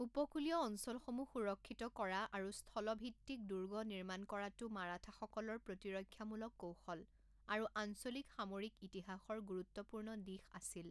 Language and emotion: Assamese, neutral